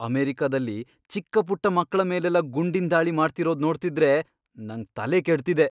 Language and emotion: Kannada, angry